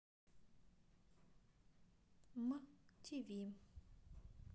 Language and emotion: Russian, neutral